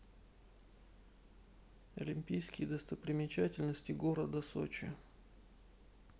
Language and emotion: Russian, neutral